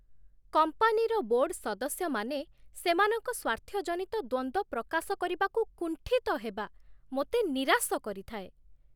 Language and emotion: Odia, disgusted